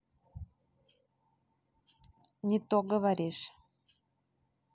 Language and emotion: Russian, neutral